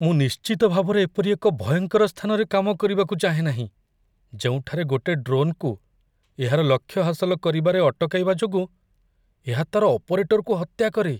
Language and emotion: Odia, fearful